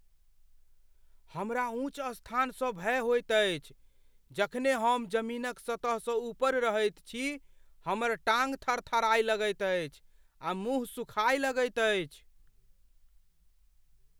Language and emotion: Maithili, fearful